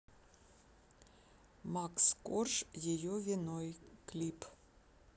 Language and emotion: Russian, neutral